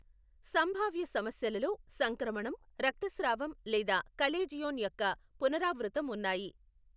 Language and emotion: Telugu, neutral